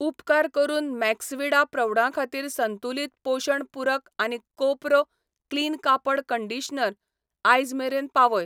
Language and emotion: Goan Konkani, neutral